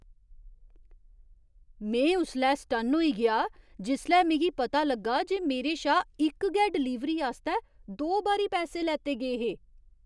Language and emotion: Dogri, surprised